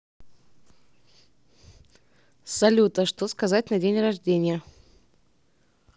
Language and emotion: Russian, neutral